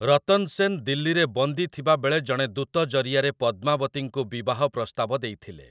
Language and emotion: Odia, neutral